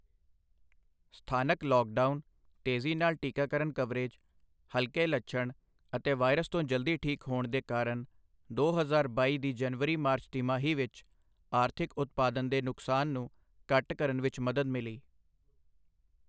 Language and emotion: Punjabi, neutral